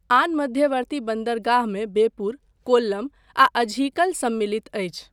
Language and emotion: Maithili, neutral